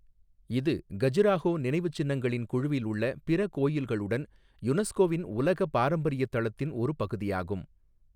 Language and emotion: Tamil, neutral